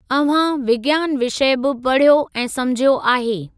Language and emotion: Sindhi, neutral